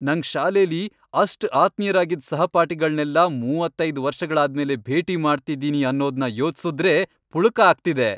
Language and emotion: Kannada, happy